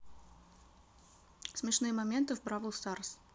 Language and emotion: Russian, neutral